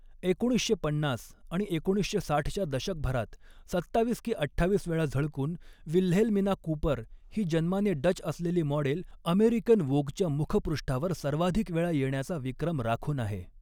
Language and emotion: Marathi, neutral